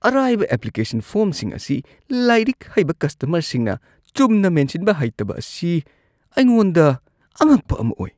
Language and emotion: Manipuri, disgusted